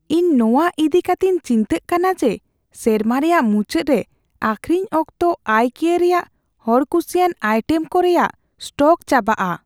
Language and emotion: Santali, fearful